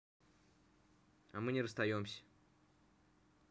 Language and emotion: Russian, neutral